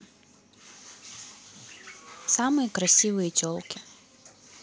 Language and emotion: Russian, neutral